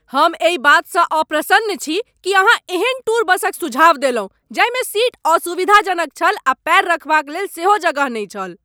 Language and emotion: Maithili, angry